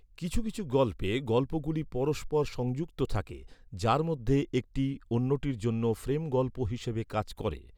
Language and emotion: Bengali, neutral